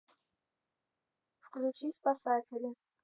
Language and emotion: Russian, neutral